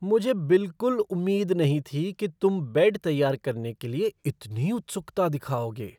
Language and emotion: Hindi, surprised